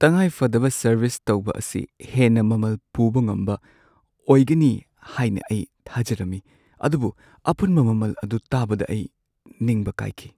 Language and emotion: Manipuri, sad